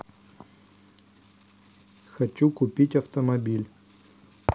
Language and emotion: Russian, neutral